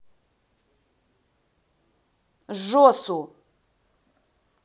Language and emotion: Russian, angry